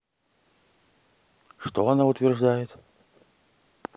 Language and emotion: Russian, neutral